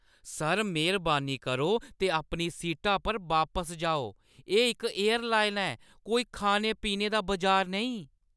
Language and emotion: Dogri, angry